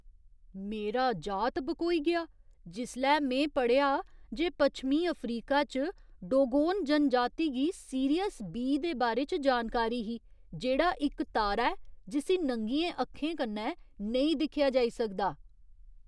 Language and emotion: Dogri, surprised